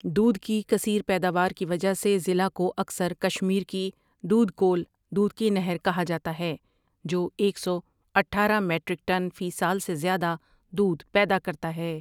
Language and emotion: Urdu, neutral